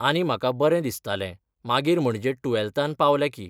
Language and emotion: Goan Konkani, neutral